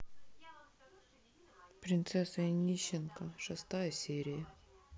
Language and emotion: Russian, sad